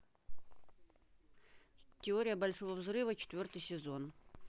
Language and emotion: Russian, neutral